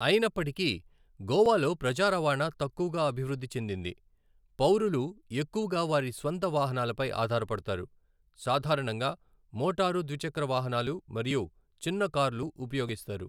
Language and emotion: Telugu, neutral